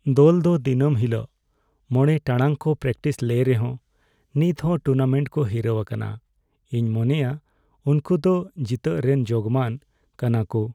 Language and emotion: Santali, sad